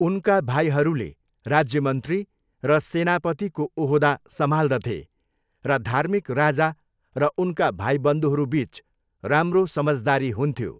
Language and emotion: Nepali, neutral